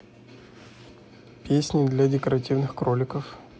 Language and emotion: Russian, neutral